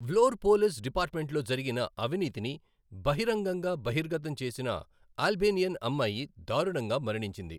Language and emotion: Telugu, neutral